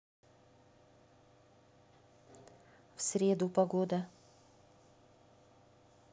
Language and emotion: Russian, neutral